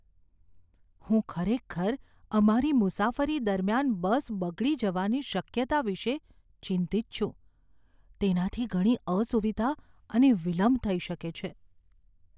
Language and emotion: Gujarati, fearful